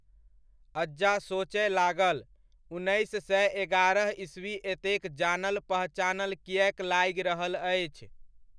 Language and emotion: Maithili, neutral